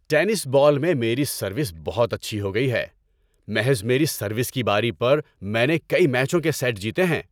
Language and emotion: Urdu, happy